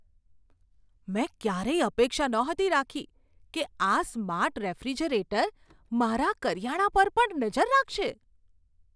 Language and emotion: Gujarati, surprised